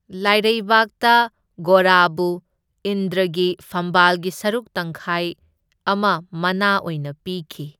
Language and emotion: Manipuri, neutral